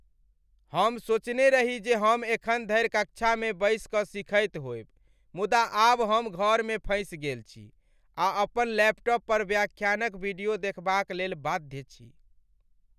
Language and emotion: Maithili, sad